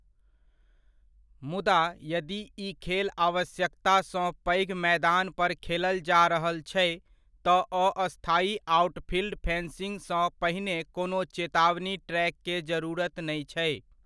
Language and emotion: Maithili, neutral